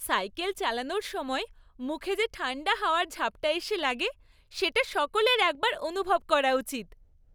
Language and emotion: Bengali, happy